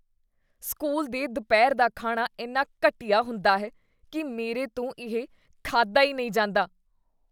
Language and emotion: Punjabi, disgusted